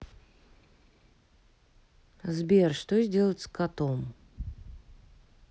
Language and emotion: Russian, neutral